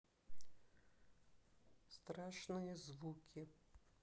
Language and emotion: Russian, neutral